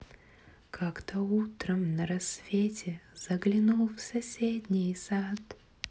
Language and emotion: Russian, positive